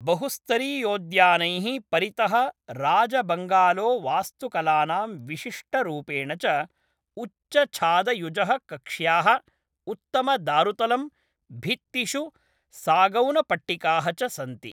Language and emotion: Sanskrit, neutral